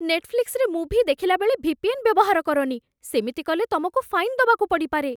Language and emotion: Odia, fearful